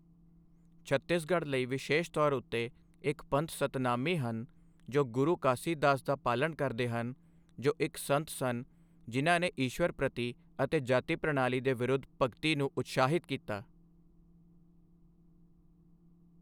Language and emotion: Punjabi, neutral